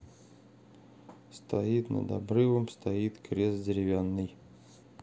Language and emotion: Russian, neutral